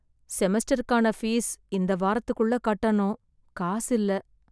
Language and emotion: Tamil, sad